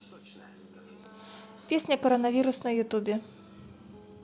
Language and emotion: Russian, neutral